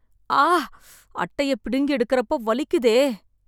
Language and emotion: Tamil, sad